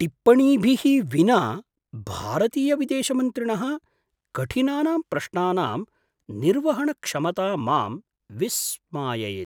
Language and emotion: Sanskrit, surprised